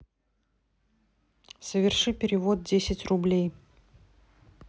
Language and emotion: Russian, neutral